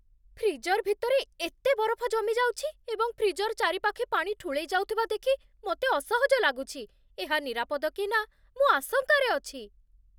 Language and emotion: Odia, fearful